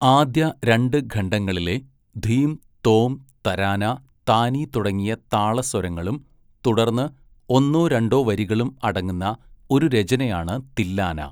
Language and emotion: Malayalam, neutral